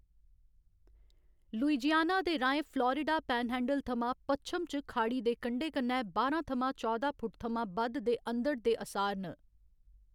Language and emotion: Dogri, neutral